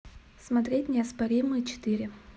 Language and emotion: Russian, neutral